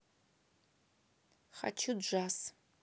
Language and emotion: Russian, neutral